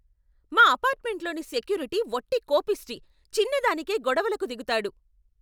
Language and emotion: Telugu, angry